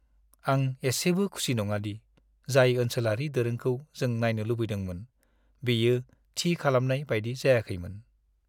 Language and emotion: Bodo, sad